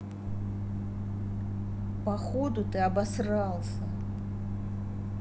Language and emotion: Russian, angry